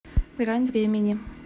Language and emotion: Russian, neutral